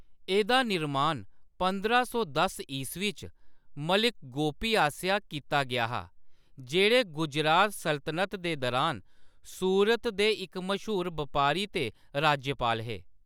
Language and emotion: Dogri, neutral